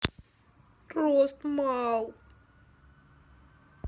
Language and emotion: Russian, sad